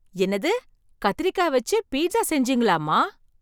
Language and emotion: Tamil, surprised